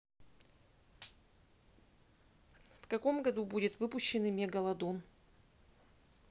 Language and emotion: Russian, neutral